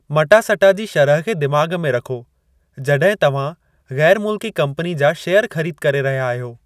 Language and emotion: Sindhi, neutral